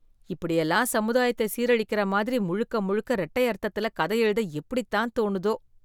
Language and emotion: Tamil, disgusted